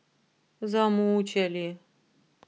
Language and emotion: Russian, sad